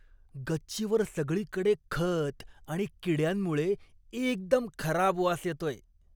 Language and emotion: Marathi, disgusted